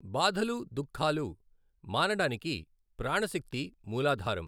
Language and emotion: Telugu, neutral